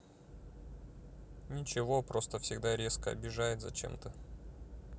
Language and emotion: Russian, sad